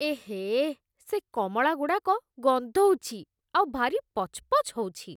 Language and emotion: Odia, disgusted